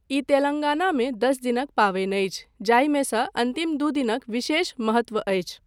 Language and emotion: Maithili, neutral